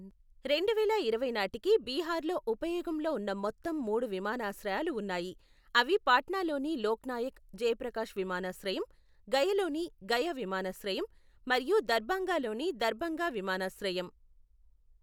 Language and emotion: Telugu, neutral